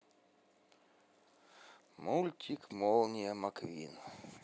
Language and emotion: Russian, neutral